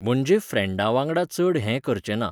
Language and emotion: Goan Konkani, neutral